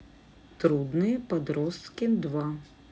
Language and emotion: Russian, neutral